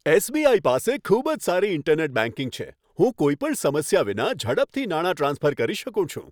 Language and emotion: Gujarati, happy